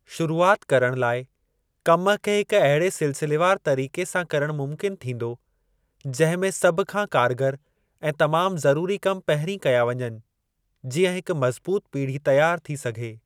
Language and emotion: Sindhi, neutral